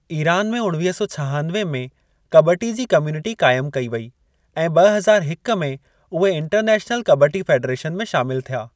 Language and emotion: Sindhi, neutral